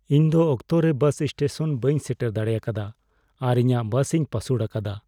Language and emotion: Santali, sad